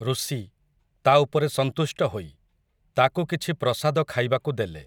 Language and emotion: Odia, neutral